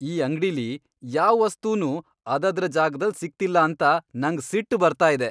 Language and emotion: Kannada, angry